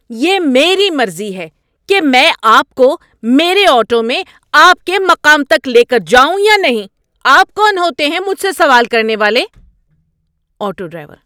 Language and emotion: Urdu, angry